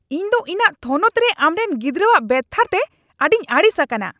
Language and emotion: Santali, angry